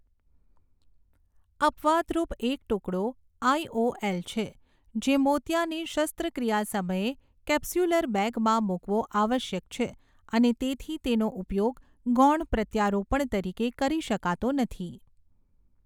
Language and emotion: Gujarati, neutral